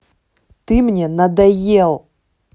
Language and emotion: Russian, angry